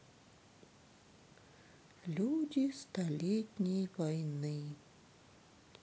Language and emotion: Russian, sad